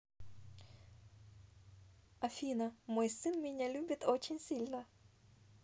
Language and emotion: Russian, positive